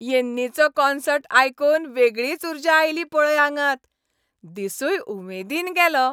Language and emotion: Goan Konkani, happy